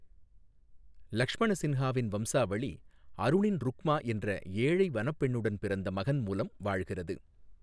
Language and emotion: Tamil, neutral